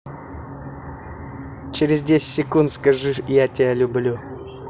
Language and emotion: Russian, positive